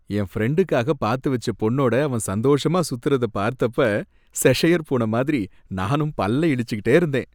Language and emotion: Tamil, happy